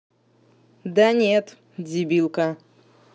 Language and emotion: Russian, angry